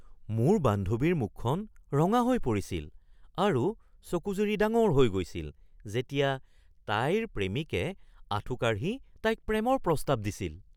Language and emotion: Assamese, surprised